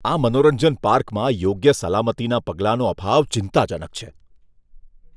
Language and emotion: Gujarati, disgusted